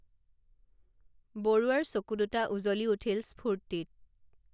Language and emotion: Assamese, neutral